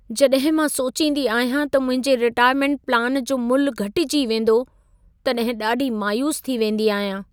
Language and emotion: Sindhi, sad